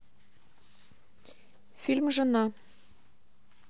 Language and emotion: Russian, neutral